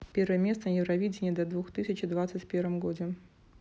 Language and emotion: Russian, neutral